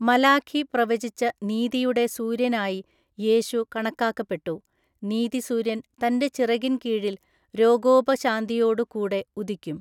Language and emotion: Malayalam, neutral